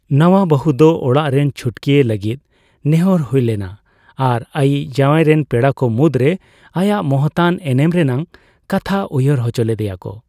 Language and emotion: Santali, neutral